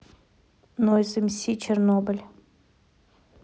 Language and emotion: Russian, neutral